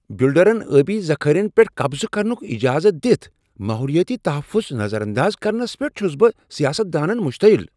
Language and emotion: Kashmiri, angry